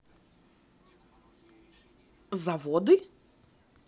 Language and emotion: Russian, neutral